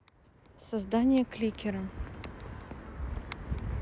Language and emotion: Russian, neutral